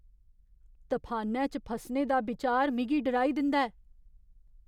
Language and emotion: Dogri, fearful